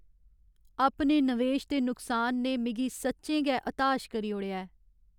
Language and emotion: Dogri, sad